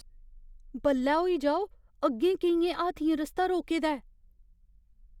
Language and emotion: Dogri, fearful